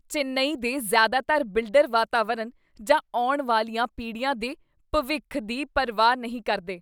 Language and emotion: Punjabi, disgusted